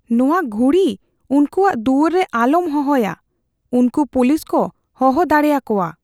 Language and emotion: Santali, fearful